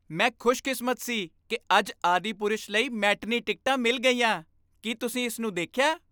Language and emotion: Punjabi, happy